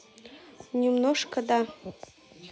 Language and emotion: Russian, neutral